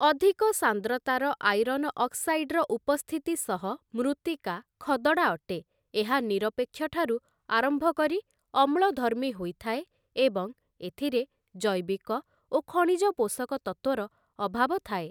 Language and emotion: Odia, neutral